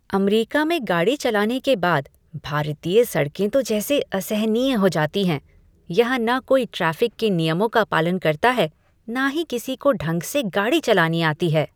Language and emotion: Hindi, disgusted